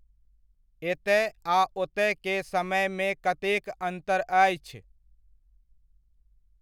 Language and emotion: Maithili, neutral